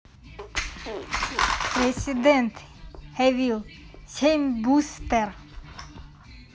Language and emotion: Russian, neutral